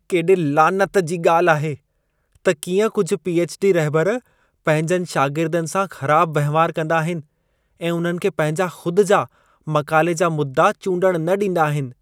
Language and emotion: Sindhi, disgusted